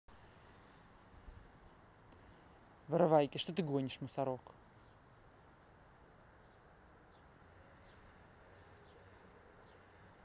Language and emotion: Russian, angry